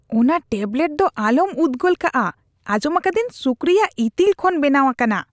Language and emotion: Santali, disgusted